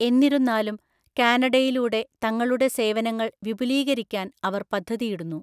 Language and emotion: Malayalam, neutral